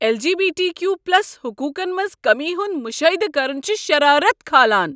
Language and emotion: Kashmiri, angry